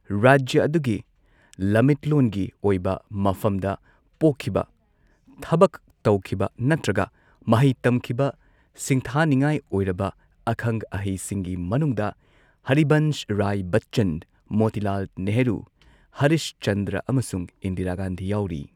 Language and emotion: Manipuri, neutral